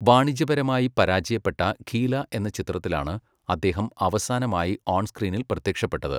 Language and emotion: Malayalam, neutral